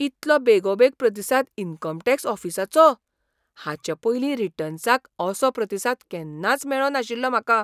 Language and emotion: Goan Konkani, surprised